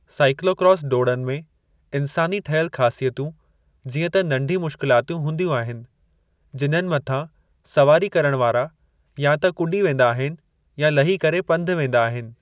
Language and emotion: Sindhi, neutral